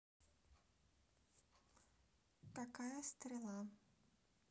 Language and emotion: Russian, neutral